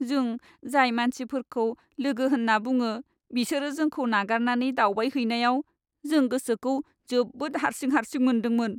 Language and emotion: Bodo, sad